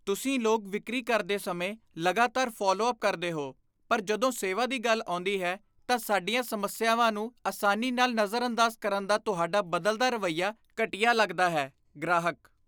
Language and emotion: Punjabi, disgusted